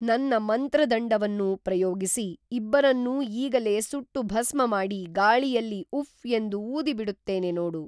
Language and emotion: Kannada, neutral